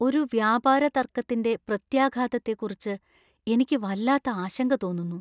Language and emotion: Malayalam, fearful